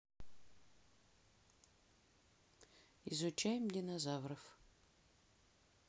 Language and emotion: Russian, neutral